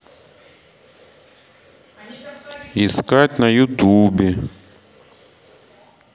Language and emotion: Russian, neutral